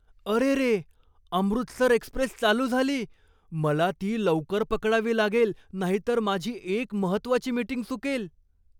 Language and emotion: Marathi, surprised